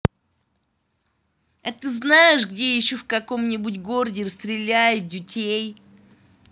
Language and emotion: Russian, angry